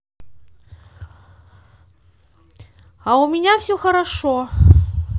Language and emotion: Russian, neutral